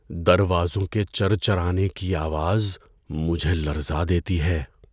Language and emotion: Urdu, fearful